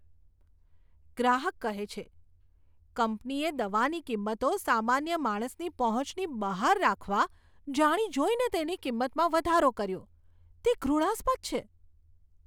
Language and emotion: Gujarati, disgusted